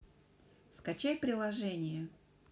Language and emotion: Russian, neutral